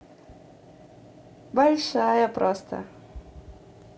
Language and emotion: Russian, positive